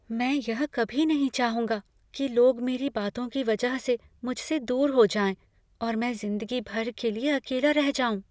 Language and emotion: Hindi, fearful